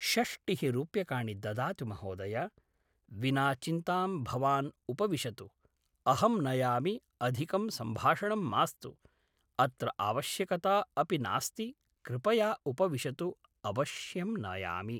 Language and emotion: Sanskrit, neutral